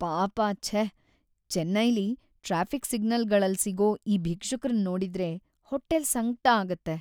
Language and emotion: Kannada, sad